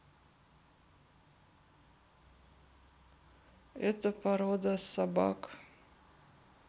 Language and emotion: Russian, sad